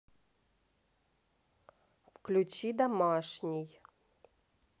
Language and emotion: Russian, neutral